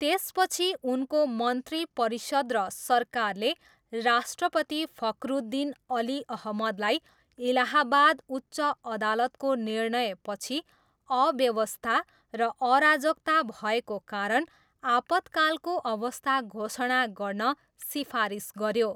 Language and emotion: Nepali, neutral